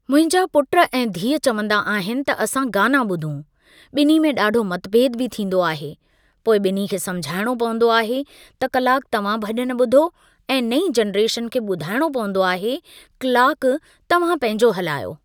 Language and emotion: Sindhi, neutral